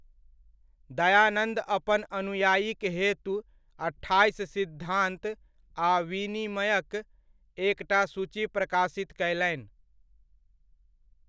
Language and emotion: Maithili, neutral